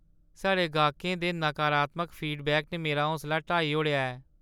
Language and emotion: Dogri, sad